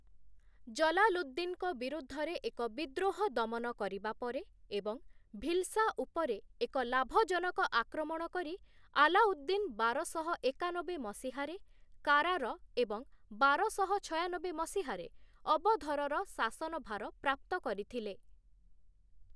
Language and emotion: Odia, neutral